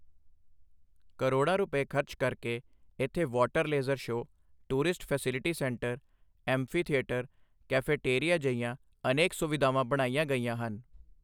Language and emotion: Punjabi, neutral